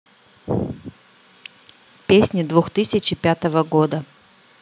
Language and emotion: Russian, neutral